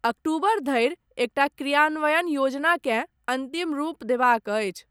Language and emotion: Maithili, neutral